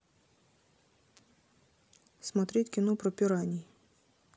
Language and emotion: Russian, neutral